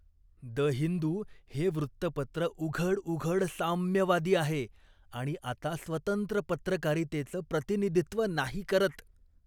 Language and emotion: Marathi, disgusted